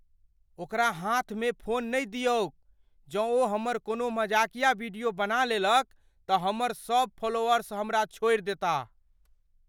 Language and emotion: Maithili, fearful